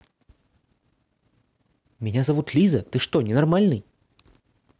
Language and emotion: Russian, angry